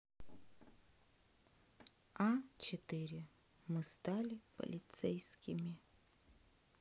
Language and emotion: Russian, sad